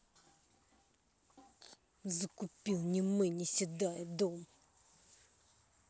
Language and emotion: Russian, angry